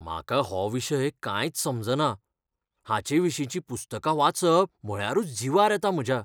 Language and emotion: Goan Konkani, fearful